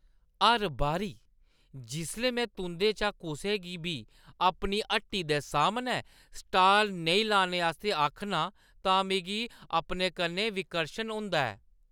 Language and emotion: Dogri, disgusted